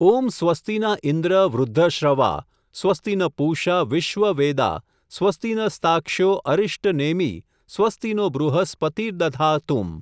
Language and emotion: Gujarati, neutral